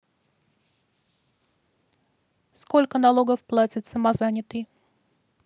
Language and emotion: Russian, neutral